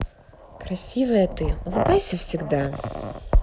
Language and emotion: Russian, positive